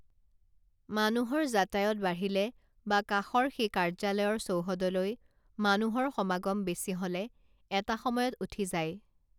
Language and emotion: Assamese, neutral